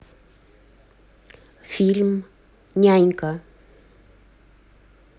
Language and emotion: Russian, neutral